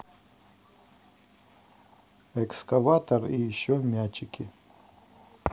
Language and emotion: Russian, neutral